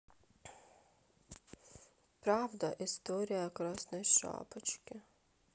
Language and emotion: Russian, sad